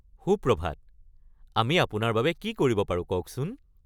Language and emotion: Assamese, happy